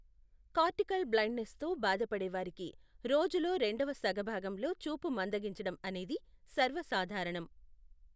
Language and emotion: Telugu, neutral